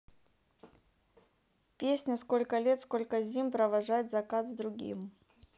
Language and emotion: Russian, neutral